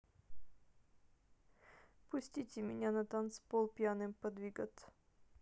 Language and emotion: Russian, sad